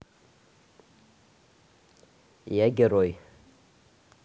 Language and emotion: Russian, neutral